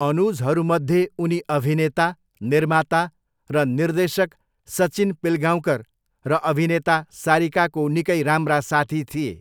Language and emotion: Nepali, neutral